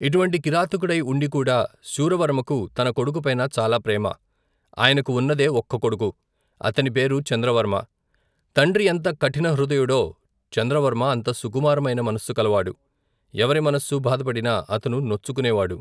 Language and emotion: Telugu, neutral